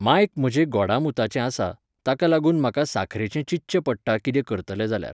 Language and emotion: Goan Konkani, neutral